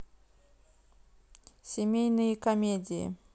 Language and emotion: Russian, neutral